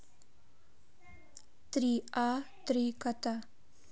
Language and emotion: Russian, neutral